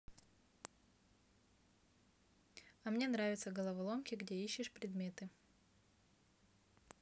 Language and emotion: Russian, neutral